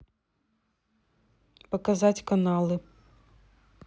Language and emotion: Russian, neutral